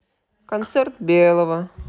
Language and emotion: Russian, neutral